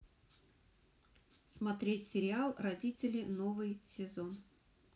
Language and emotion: Russian, neutral